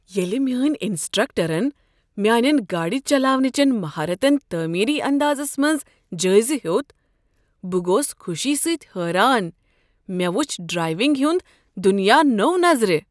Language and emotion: Kashmiri, surprised